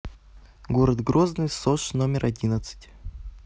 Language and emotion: Russian, neutral